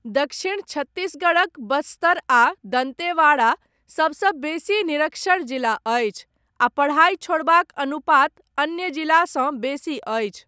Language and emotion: Maithili, neutral